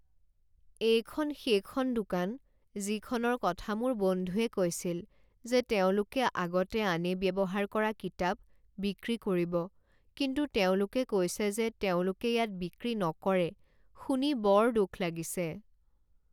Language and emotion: Assamese, sad